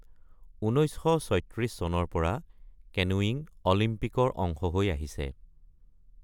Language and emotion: Assamese, neutral